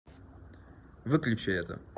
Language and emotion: Russian, neutral